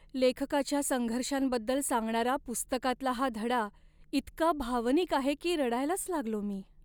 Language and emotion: Marathi, sad